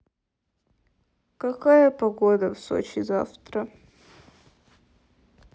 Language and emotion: Russian, sad